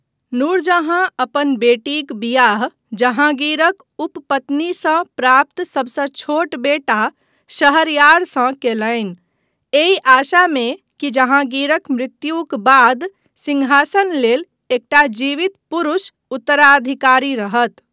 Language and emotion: Maithili, neutral